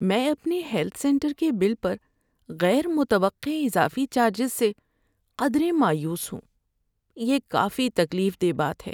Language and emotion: Urdu, sad